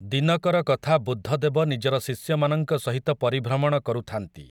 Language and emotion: Odia, neutral